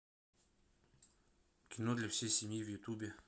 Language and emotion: Russian, neutral